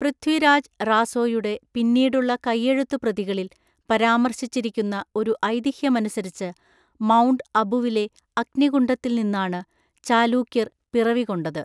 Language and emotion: Malayalam, neutral